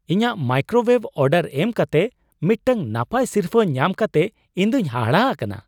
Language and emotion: Santali, surprised